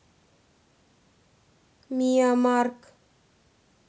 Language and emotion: Russian, neutral